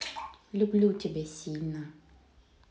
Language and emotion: Russian, neutral